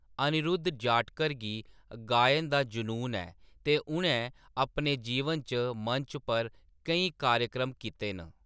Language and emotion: Dogri, neutral